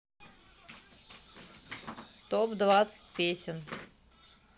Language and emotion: Russian, neutral